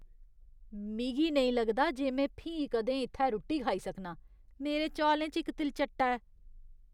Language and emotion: Dogri, disgusted